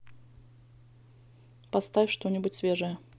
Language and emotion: Russian, neutral